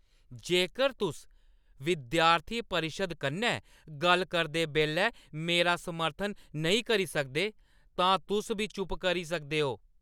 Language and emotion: Dogri, angry